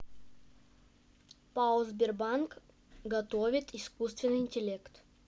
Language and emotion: Russian, neutral